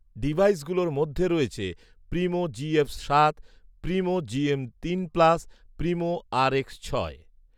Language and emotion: Bengali, neutral